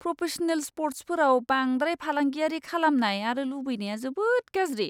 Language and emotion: Bodo, disgusted